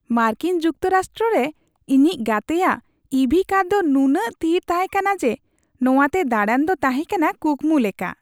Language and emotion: Santali, happy